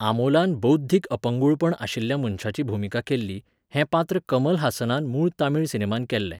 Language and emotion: Goan Konkani, neutral